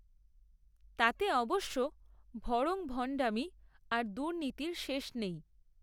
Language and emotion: Bengali, neutral